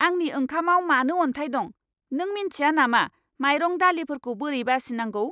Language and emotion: Bodo, angry